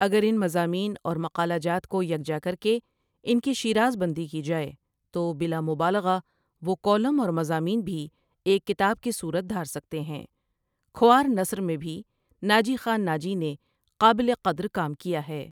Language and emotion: Urdu, neutral